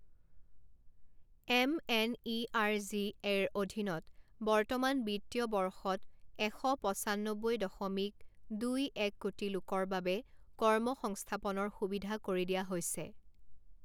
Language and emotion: Assamese, neutral